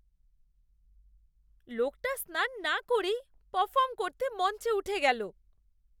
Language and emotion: Bengali, disgusted